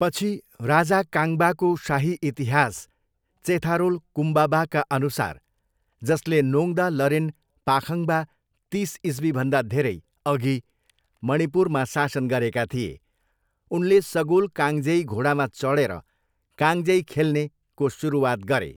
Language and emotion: Nepali, neutral